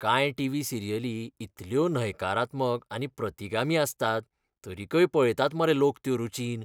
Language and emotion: Goan Konkani, disgusted